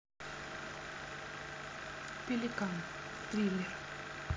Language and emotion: Russian, neutral